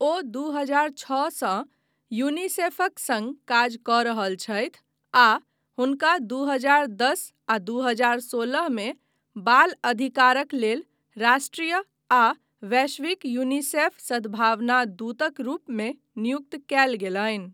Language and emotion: Maithili, neutral